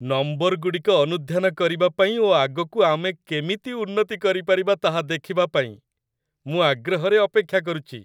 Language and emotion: Odia, happy